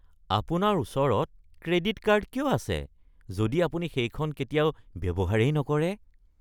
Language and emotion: Assamese, disgusted